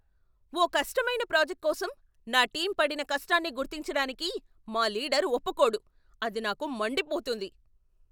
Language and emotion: Telugu, angry